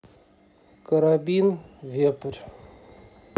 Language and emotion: Russian, neutral